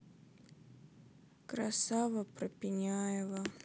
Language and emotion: Russian, sad